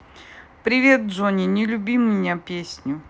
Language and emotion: Russian, neutral